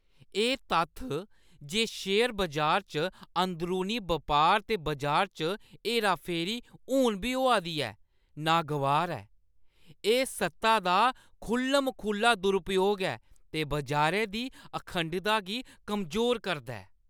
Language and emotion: Dogri, disgusted